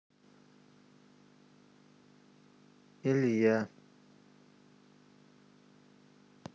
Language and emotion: Russian, neutral